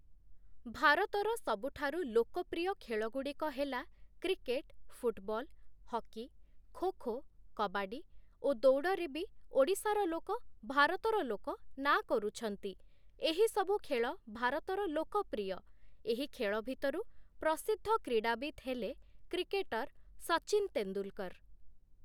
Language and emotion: Odia, neutral